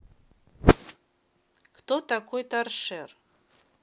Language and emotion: Russian, neutral